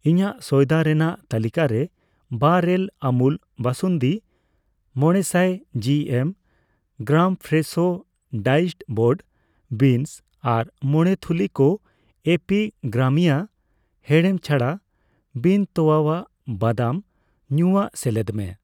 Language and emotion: Santali, neutral